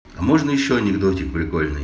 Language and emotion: Russian, positive